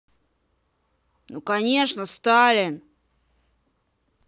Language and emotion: Russian, angry